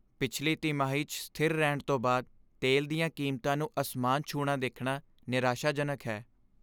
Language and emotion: Punjabi, sad